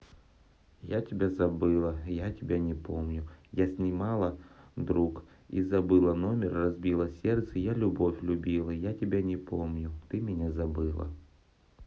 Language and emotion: Russian, neutral